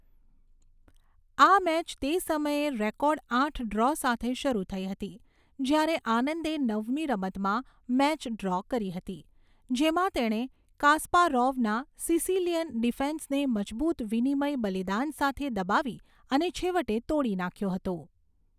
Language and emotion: Gujarati, neutral